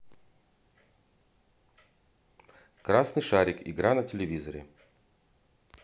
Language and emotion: Russian, neutral